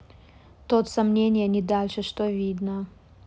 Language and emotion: Russian, neutral